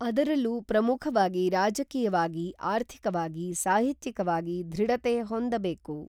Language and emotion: Kannada, neutral